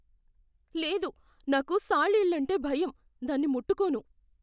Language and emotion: Telugu, fearful